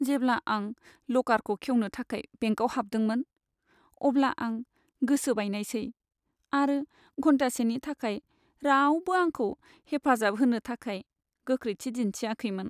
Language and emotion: Bodo, sad